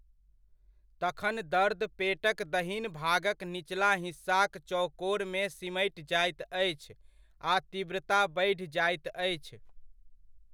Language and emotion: Maithili, neutral